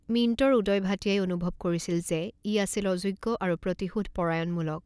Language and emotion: Assamese, neutral